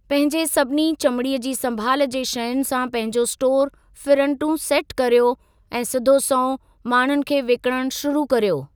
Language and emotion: Sindhi, neutral